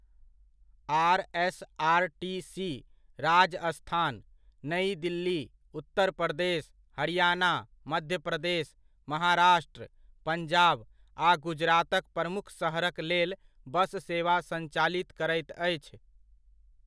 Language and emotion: Maithili, neutral